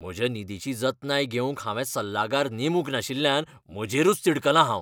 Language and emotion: Goan Konkani, angry